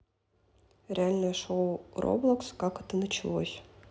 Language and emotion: Russian, neutral